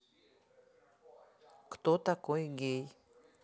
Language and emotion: Russian, neutral